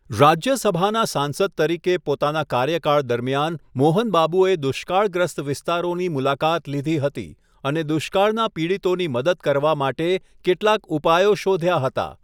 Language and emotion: Gujarati, neutral